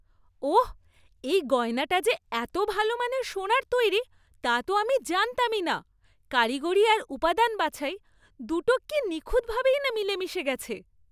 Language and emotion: Bengali, surprised